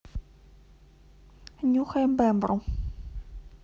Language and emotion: Russian, neutral